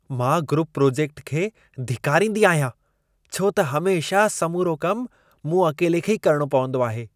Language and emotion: Sindhi, disgusted